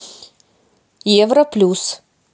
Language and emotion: Russian, neutral